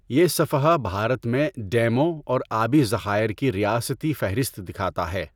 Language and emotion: Urdu, neutral